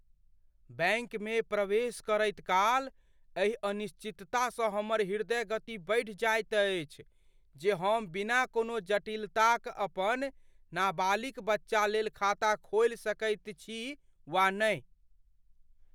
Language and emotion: Maithili, fearful